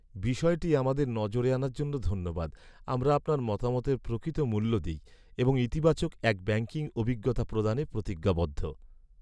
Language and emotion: Bengali, sad